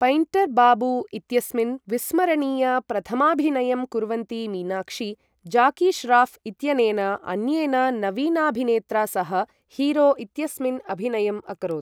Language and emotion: Sanskrit, neutral